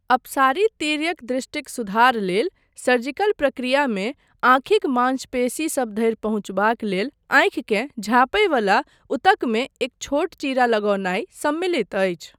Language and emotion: Maithili, neutral